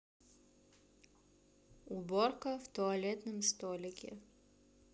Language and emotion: Russian, neutral